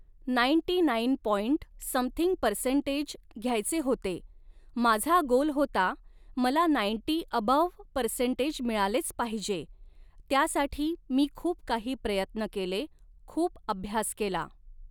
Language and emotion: Marathi, neutral